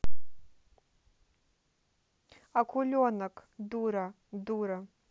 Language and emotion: Russian, neutral